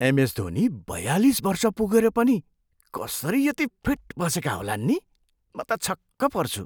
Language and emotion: Nepali, surprised